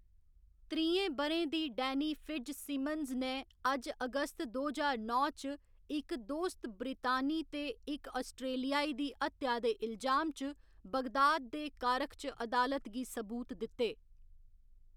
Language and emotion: Dogri, neutral